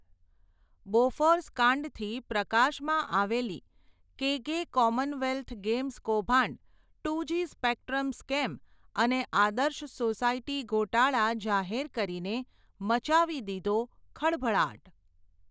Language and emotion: Gujarati, neutral